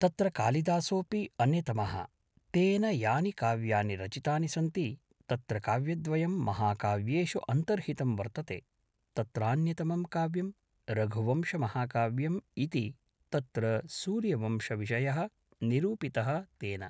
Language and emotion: Sanskrit, neutral